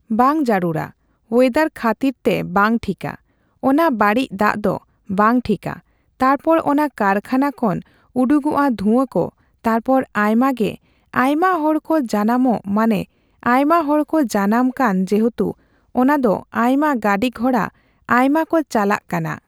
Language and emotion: Santali, neutral